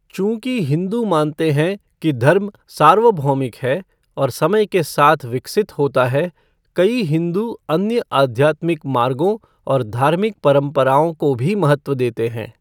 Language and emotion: Hindi, neutral